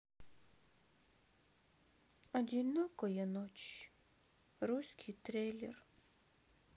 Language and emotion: Russian, sad